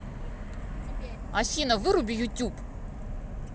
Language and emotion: Russian, angry